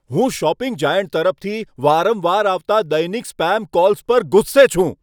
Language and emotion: Gujarati, angry